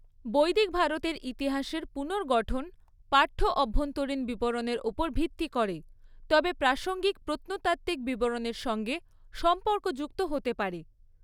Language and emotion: Bengali, neutral